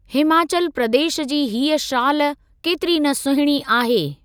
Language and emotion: Sindhi, neutral